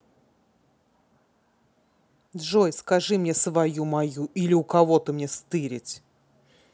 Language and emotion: Russian, angry